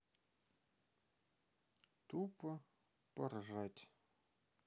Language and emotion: Russian, sad